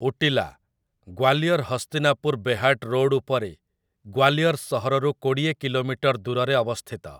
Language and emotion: Odia, neutral